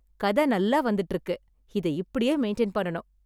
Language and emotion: Tamil, happy